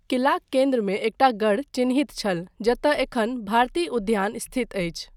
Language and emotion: Maithili, neutral